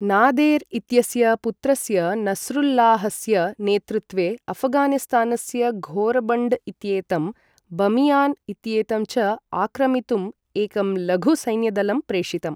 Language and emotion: Sanskrit, neutral